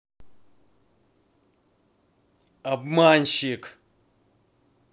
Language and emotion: Russian, angry